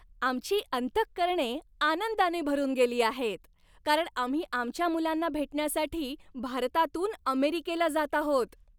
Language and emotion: Marathi, happy